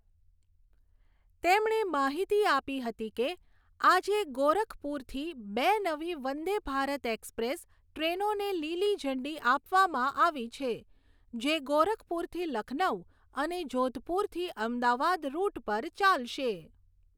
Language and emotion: Gujarati, neutral